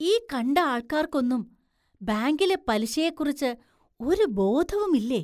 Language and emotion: Malayalam, surprised